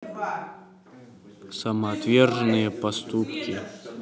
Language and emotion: Russian, neutral